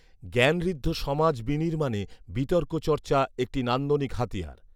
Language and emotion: Bengali, neutral